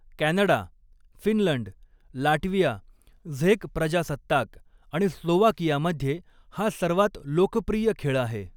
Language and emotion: Marathi, neutral